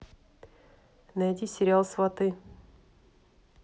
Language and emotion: Russian, neutral